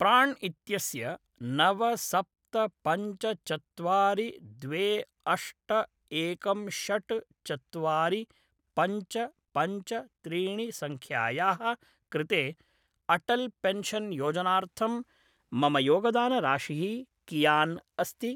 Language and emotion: Sanskrit, neutral